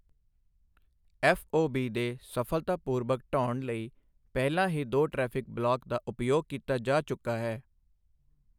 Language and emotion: Punjabi, neutral